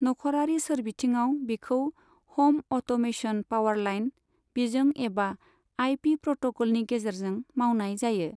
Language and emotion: Bodo, neutral